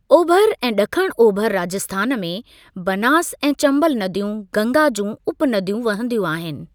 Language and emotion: Sindhi, neutral